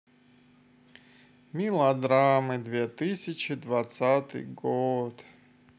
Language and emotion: Russian, sad